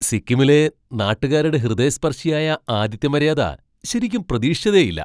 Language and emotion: Malayalam, surprised